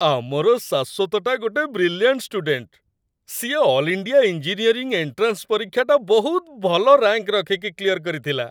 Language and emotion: Odia, happy